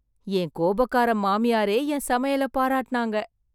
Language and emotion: Tamil, surprised